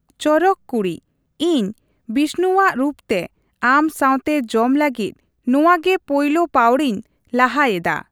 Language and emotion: Santali, neutral